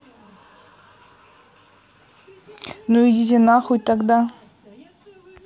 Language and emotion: Russian, neutral